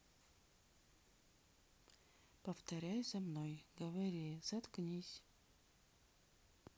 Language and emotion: Russian, neutral